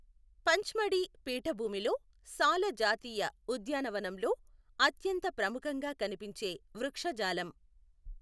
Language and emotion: Telugu, neutral